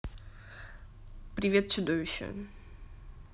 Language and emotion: Russian, neutral